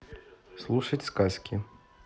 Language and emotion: Russian, neutral